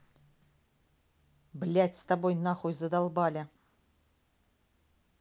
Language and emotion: Russian, angry